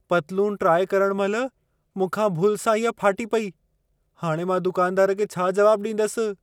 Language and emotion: Sindhi, fearful